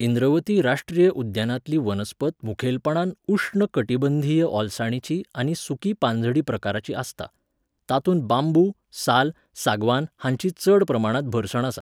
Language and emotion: Goan Konkani, neutral